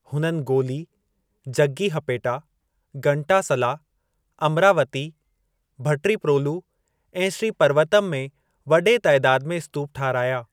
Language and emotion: Sindhi, neutral